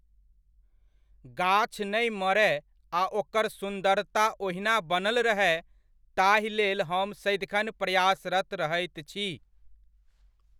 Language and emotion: Maithili, neutral